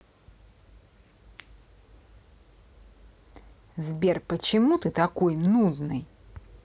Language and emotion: Russian, angry